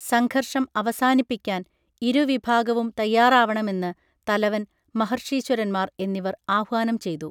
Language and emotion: Malayalam, neutral